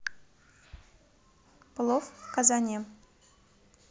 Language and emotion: Russian, neutral